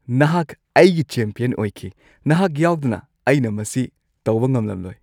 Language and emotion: Manipuri, happy